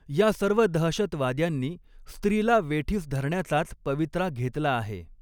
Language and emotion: Marathi, neutral